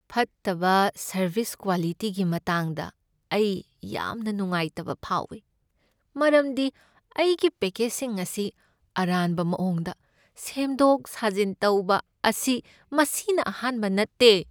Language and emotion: Manipuri, sad